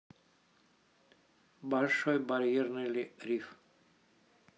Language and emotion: Russian, neutral